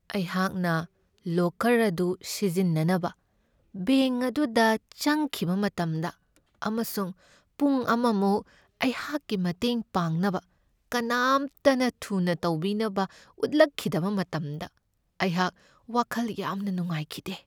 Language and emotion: Manipuri, sad